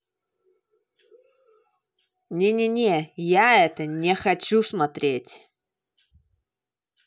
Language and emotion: Russian, angry